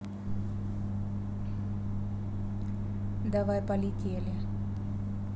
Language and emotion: Russian, neutral